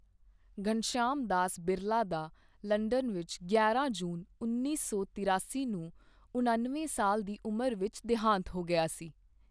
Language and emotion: Punjabi, neutral